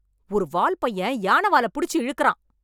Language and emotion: Tamil, angry